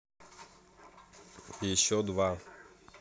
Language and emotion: Russian, neutral